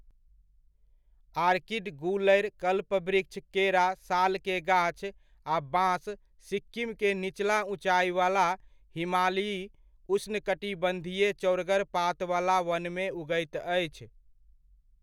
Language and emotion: Maithili, neutral